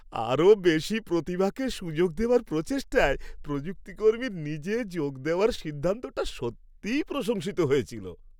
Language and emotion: Bengali, happy